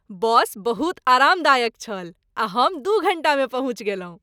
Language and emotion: Maithili, happy